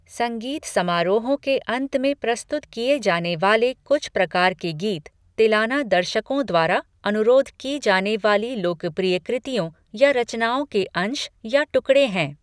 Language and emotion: Hindi, neutral